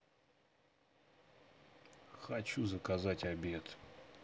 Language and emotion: Russian, neutral